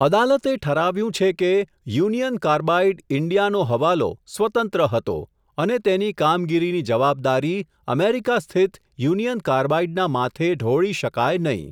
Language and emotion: Gujarati, neutral